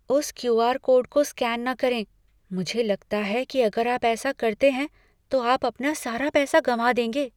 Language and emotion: Hindi, fearful